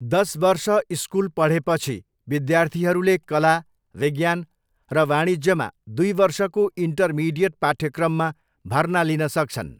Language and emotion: Nepali, neutral